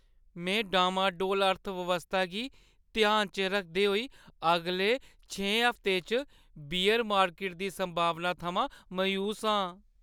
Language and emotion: Dogri, sad